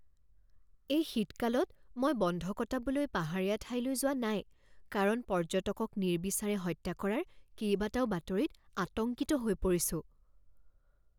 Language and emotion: Assamese, fearful